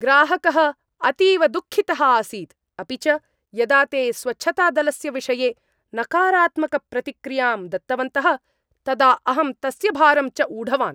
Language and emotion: Sanskrit, angry